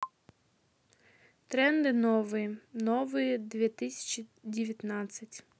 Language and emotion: Russian, neutral